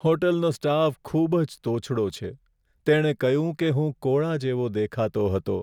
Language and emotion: Gujarati, sad